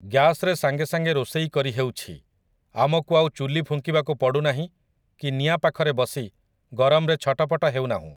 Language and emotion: Odia, neutral